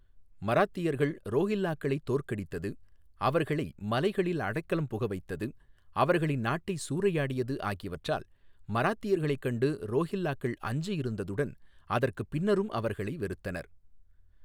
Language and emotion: Tamil, neutral